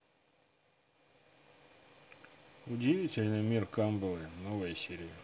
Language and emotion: Russian, neutral